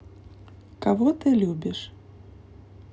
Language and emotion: Russian, neutral